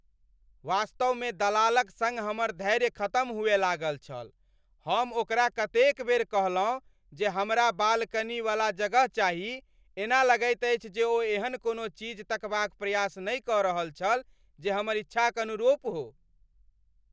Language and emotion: Maithili, angry